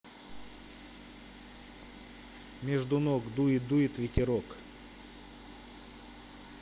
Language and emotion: Russian, neutral